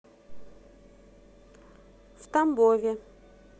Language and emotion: Russian, neutral